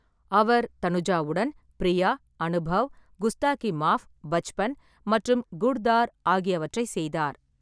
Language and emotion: Tamil, neutral